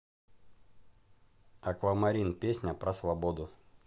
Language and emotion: Russian, neutral